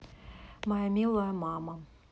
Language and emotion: Russian, neutral